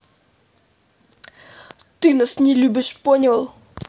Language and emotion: Russian, angry